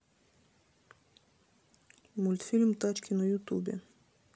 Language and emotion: Russian, neutral